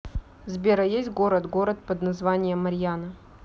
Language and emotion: Russian, neutral